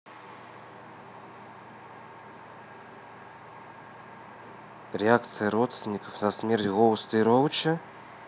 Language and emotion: Russian, neutral